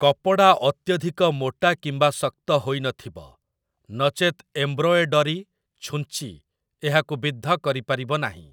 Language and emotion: Odia, neutral